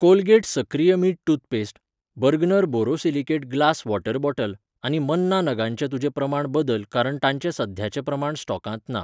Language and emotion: Goan Konkani, neutral